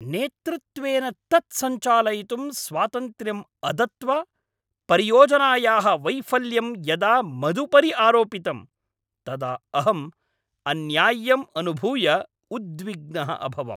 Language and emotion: Sanskrit, angry